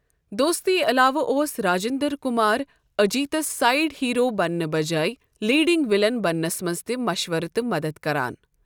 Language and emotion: Kashmiri, neutral